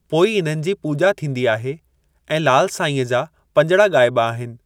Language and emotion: Sindhi, neutral